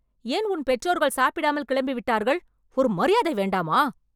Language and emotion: Tamil, angry